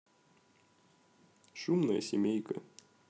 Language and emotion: Russian, neutral